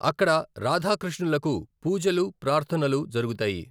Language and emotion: Telugu, neutral